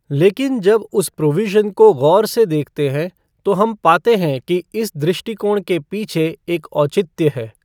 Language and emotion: Hindi, neutral